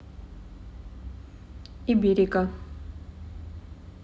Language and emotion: Russian, neutral